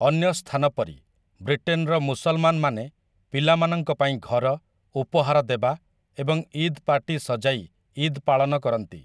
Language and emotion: Odia, neutral